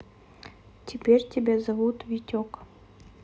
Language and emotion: Russian, neutral